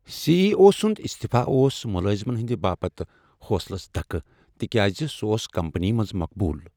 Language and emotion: Kashmiri, sad